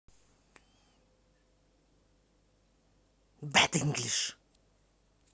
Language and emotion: Russian, angry